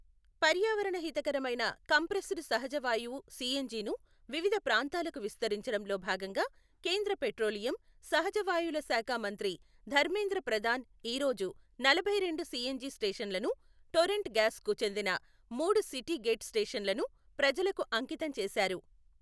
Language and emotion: Telugu, neutral